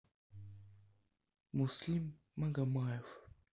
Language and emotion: Russian, sad